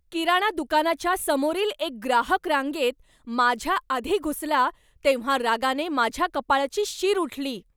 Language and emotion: Marathi, angry